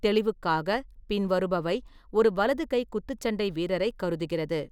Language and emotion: Tamil, neutral